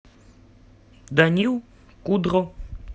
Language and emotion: Russian, neutral